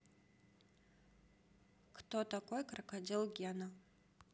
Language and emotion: Russian, neutral